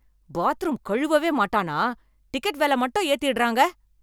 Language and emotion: Tamil, angry